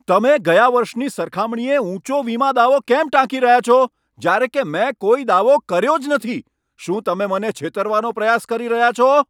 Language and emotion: Gujarati, angry